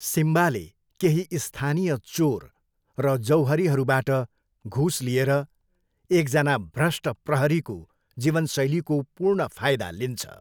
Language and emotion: Nepali, neutral